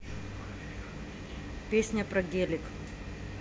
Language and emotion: Russian, neutral